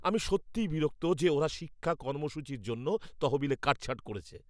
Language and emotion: Bengali, angry